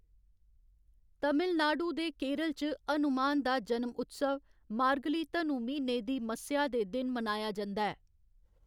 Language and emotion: Dogri, neutral